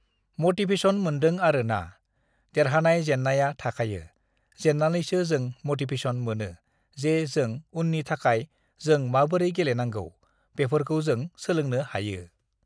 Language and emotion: Bodo, neutral